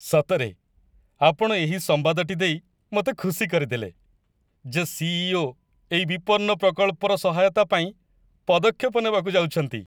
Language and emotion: Odia, happy